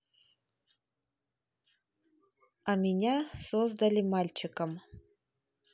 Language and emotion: Russian, neutral